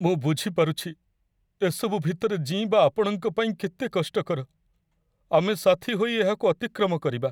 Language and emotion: Odia, sad